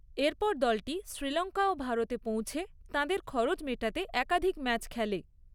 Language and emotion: Bengali, neutral